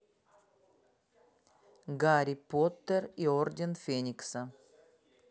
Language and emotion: Russian, neutral